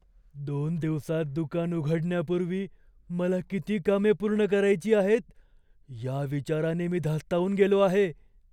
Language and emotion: Marathi, fearful